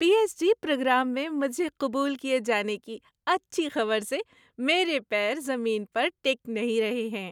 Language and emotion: Urdu, happy